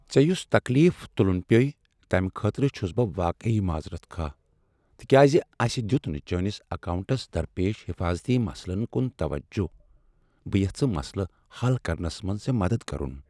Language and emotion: Kashmiri, sad